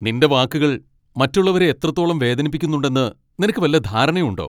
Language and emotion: Malayalam, angry